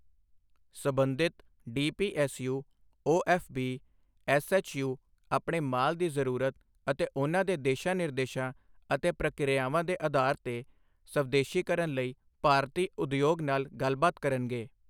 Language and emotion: Punjabi, neutral